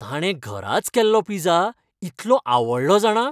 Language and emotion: Goan Konkani, happy